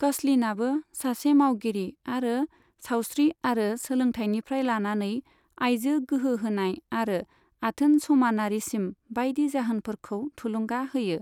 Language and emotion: Bodo, neutral